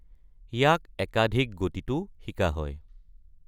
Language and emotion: Assamese, neutral